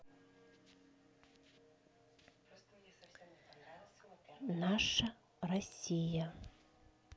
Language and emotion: Russian, neutral